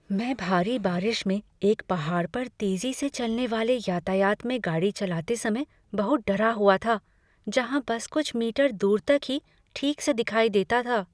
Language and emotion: Hindi, fearful